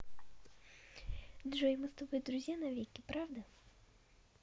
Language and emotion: Russian, positive